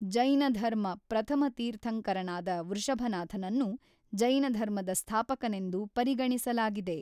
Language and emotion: Kannada, neutral